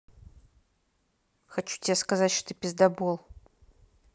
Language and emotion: Russian, angry